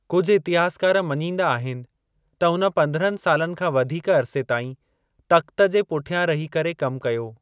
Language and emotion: Sindhi, neutral